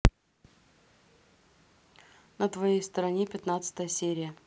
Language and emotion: Russian, neutral